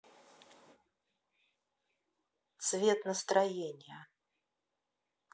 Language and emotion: Russian, neutral